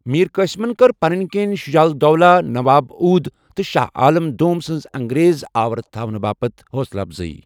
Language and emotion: Kashmiri, neutral